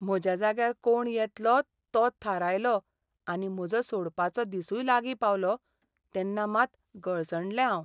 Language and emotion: Goan Konkani, sad